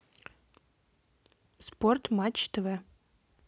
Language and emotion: Russian, neutral